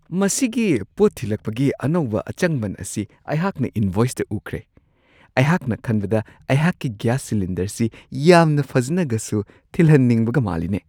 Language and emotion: Manipuri, surprised